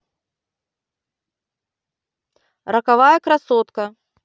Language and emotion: Russian, neutral